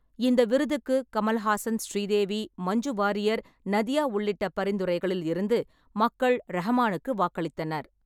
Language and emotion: Tamil, neutral